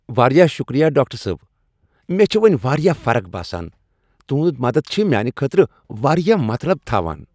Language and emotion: Kashmiri, happy